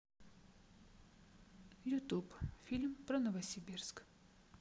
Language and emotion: Russian, neutral